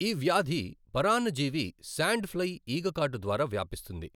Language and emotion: Telugu, neutral